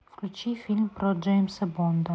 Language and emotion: Russian, neutral